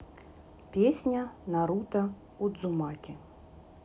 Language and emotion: Russian, neutral